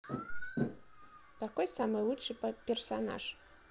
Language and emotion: Russian, neutral